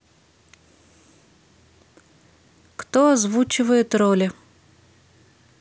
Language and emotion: Russian, neutral